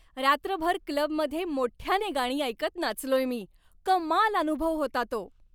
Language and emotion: Marathi, happy